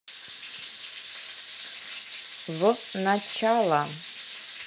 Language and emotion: Russian, neutral